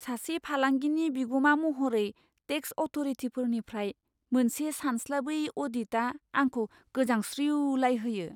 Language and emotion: Bodo, fearful